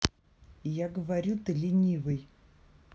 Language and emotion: Russian, neutral